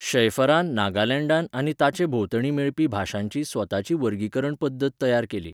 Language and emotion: Goan Konkani, neutral